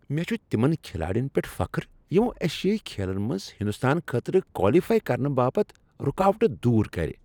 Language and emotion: Kashmiri, happy